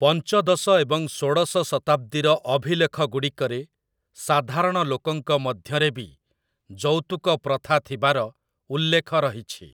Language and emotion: Odia, neutral